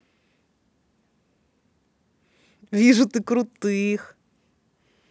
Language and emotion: Russian, positive